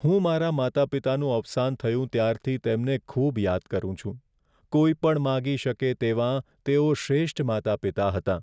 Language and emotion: Gujarati, sad